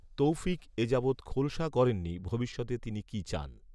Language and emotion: Bengali, neutral